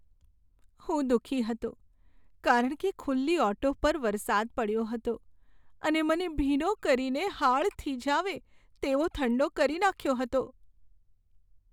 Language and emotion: Gujarati, sad